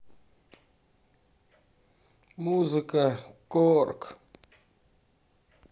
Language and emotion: Russian, neutral